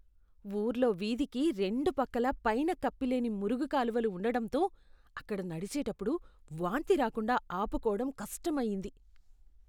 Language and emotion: Telugu, disgusted